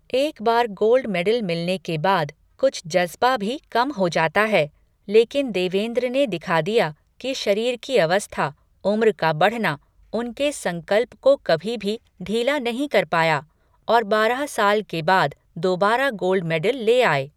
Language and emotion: Hindi, neutral